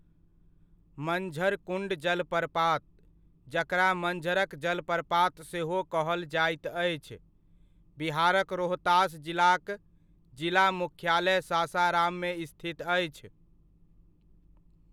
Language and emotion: Maithili, neutral